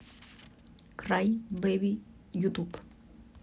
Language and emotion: Russian, neutral